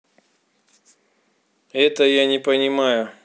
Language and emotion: Russian, neutral